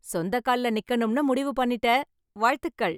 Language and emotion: Tamil, happy